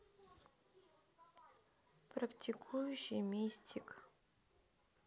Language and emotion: Russian, sad